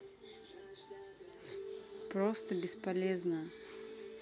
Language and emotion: Russian, neutral